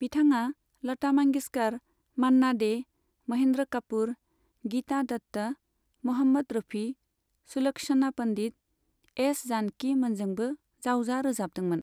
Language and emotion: Bodo, neutral